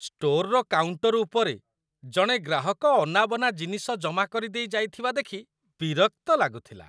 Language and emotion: Odia, disgusted